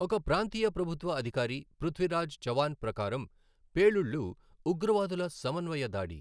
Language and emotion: Telugu, neutral